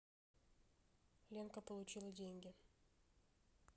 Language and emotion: Russian, neutral